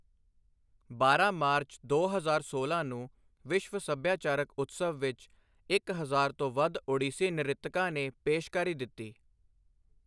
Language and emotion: Punjabi, neutral